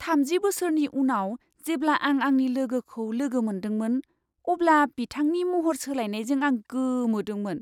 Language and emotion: Bodo, surprised